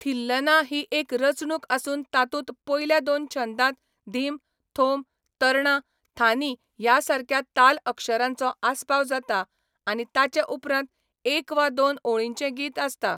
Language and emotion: Goan Konkani, neutral